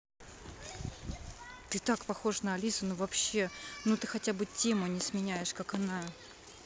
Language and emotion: Russian, neutral